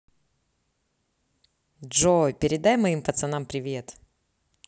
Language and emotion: Russian, positive